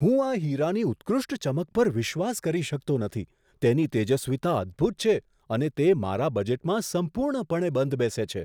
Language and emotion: Gujarati, surprised